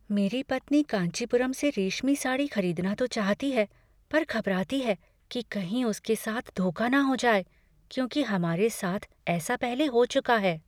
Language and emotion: Hindi, fearful